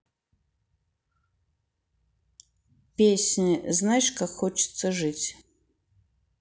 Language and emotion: Russian, neutral